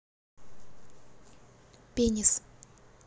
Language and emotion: Russian, neutral